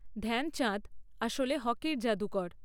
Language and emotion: Bengali, neutral